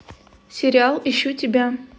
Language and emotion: Russian, neutral